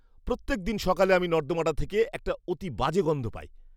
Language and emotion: Bengali, disgusted